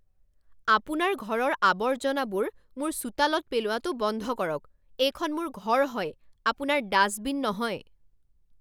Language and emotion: Assamese, angry